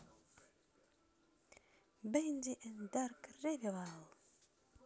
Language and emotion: Russian, positive